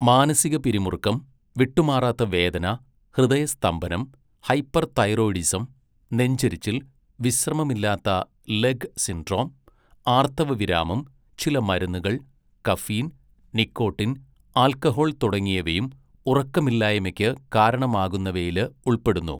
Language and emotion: Malayalam, neutral